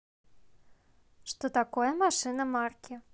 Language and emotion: Russian, neutral